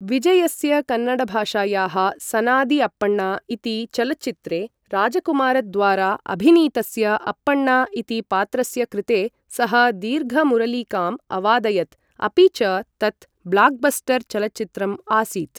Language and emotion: Sanskrit, neutral